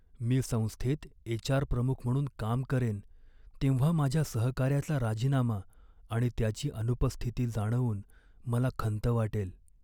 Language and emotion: Marathi, sad